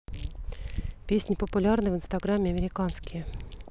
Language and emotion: Russian, neutral